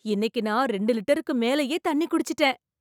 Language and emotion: Tamil, surprised